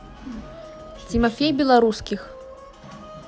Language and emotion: Russian, neutral